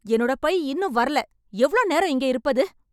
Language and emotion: Tamil, angry